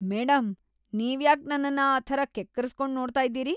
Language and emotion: Kannada, disgusted